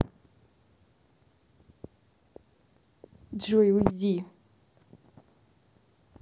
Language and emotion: Russian, angry